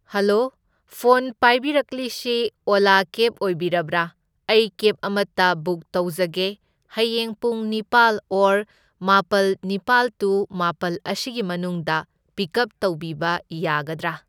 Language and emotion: Manipuri, neutral